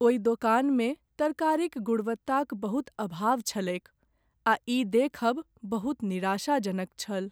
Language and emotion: Maithili, sad